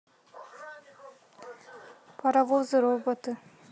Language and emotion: Russian, neutral